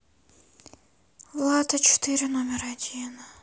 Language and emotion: Russian, sad